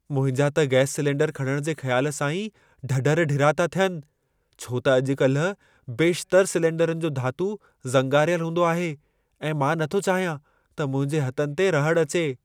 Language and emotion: Sindhi, fearful